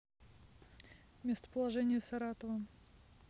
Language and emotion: Russian, neutral